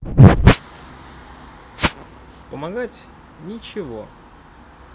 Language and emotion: Russian, neutral